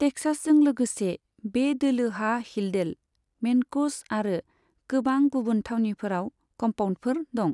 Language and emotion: Bodo, neutral